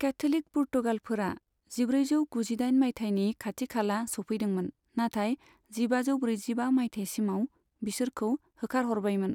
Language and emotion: Bodo, neutral